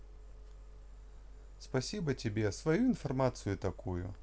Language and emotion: Russian, positive